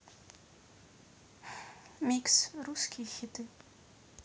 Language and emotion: Russian, neutral